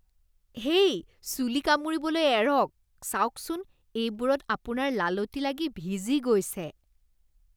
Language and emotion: Assamese, disgusted